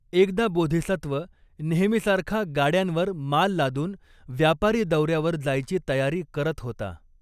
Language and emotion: Marathi, neutral